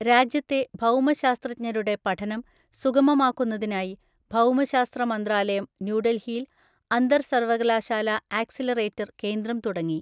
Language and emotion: Malayalam, neutral